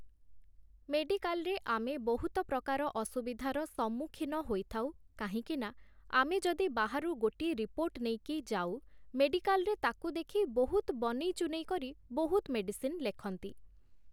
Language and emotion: Odia, neutral